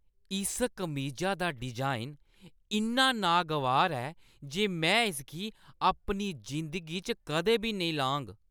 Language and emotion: Dogri, disgusted